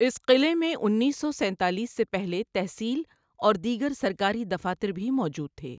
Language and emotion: Urdu, neutral